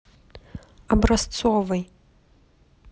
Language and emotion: Russian, neutral